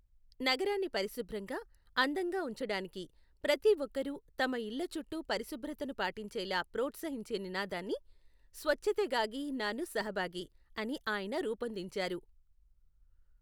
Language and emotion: Telugu, neutral